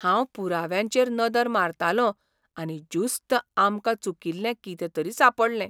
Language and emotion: Goan Konkani, surprised